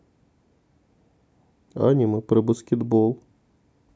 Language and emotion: Russian, neutral